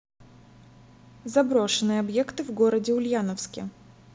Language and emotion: Russian, neutral